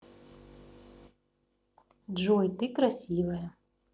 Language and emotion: Russian, positive